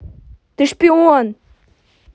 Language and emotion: Russian, angry